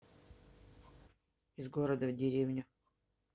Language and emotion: Russian, neutral